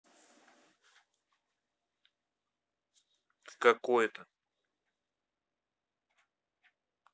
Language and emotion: Russian, neutral